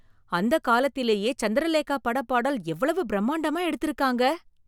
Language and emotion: Tamil, surprised